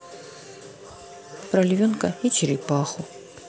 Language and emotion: Russian, neutral